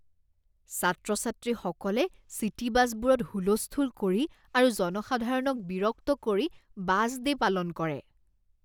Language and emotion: Assamese, disgusted